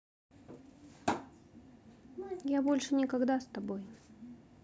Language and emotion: Russian, sad